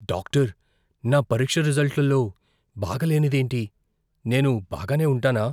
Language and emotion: Telugu, fearful